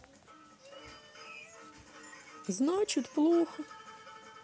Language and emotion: Russian, sad